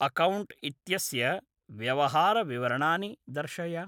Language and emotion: Sanskrit, neutral